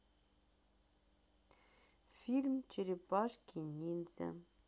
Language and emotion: Russian, sad